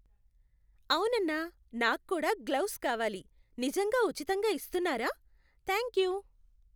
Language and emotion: Telugu, happy